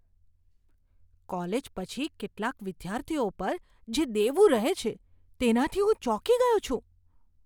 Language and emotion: Gujarati, surprised